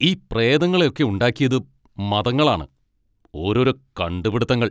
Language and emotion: Malayalam, angry